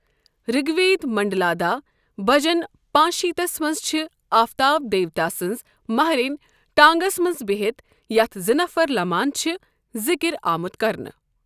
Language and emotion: Kashmiri, neutral